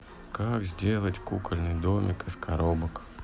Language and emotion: Russian, neutral